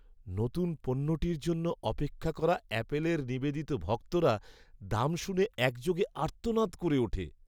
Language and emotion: Bengali, sad